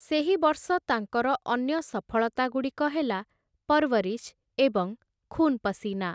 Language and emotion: Odia, neutral